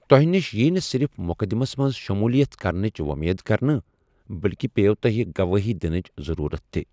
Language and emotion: Kashmiri, neutral